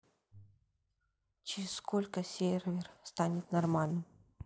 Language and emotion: Russian, neutral